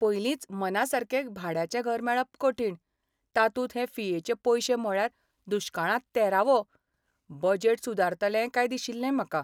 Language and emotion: Goan Konkani, sad